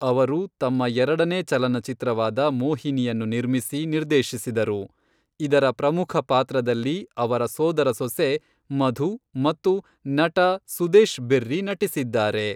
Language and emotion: Kannada, neutral